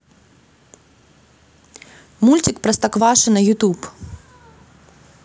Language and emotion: Russian, neutral